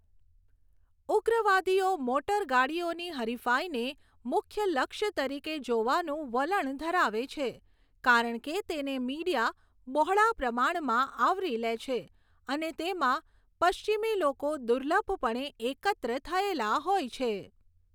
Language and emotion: Gujarati, neutral